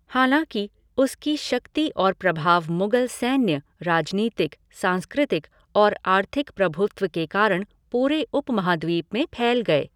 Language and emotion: Hindi, neutral